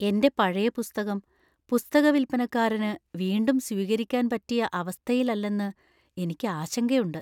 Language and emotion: Malayalam, fearful